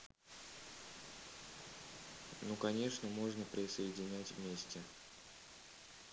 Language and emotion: Russian, neutral